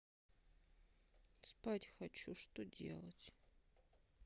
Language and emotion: Russian, sad